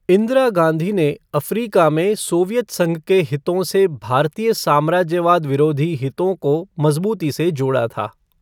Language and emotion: Hindi, neutral